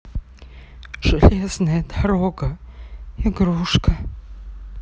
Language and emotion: Russian, sad